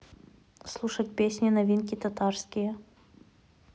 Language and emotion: Russian, neutral